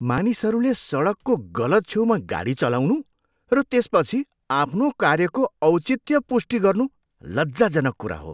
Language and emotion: Nepali, disgusted